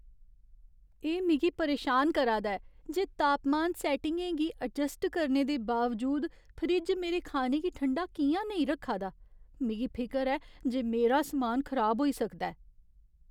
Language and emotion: Dogri, fearful